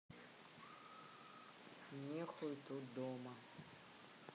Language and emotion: Russian, neutral